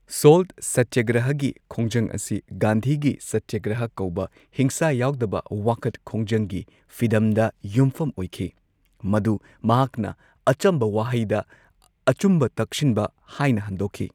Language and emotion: Manipuri, neutral